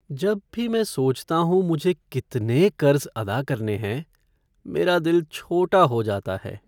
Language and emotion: Hindi, sad